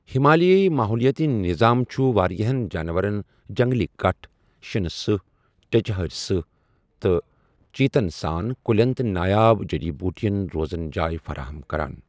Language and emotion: Kashmiri, neutral